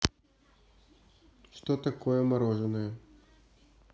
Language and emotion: Russian, neutral